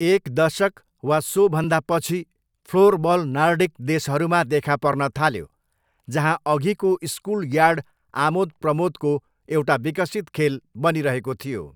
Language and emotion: Nepali, neutral